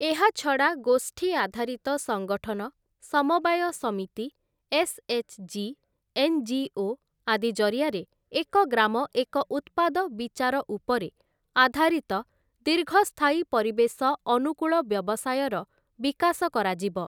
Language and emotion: Odia, neutral